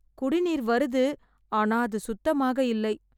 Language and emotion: Tamil, sad